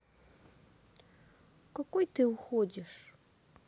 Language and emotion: Russian, sad